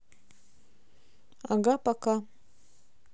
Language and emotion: Russian, neutral